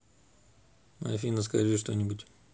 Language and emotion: Russian, neutral